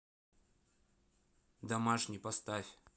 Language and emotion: Russian, neutral